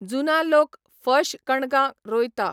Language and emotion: Goan Konkani, neutral